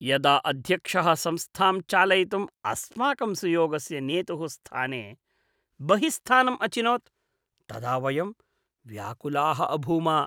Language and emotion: Sanskrit, disgusted